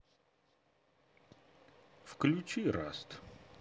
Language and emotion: Russian, neutral